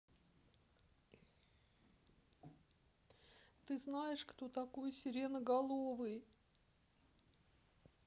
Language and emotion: Russian, sad